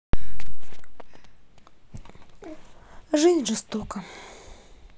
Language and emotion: Russian, sad